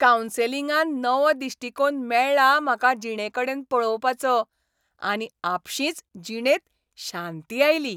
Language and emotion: Goan Konkani, happy